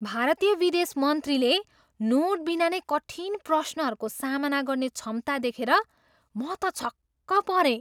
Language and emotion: Nepali, surprised